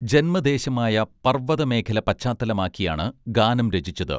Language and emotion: Malayalam, neutral